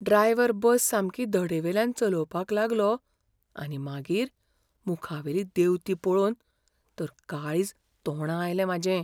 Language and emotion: Goan Konkani, fearful